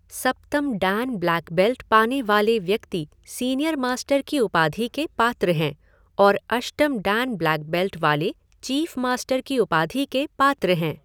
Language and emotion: Hindi, neutral